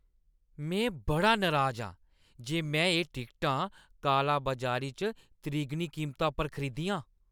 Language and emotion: Dogri, angry